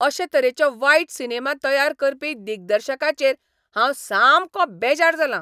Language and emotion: Goan Konkani, angry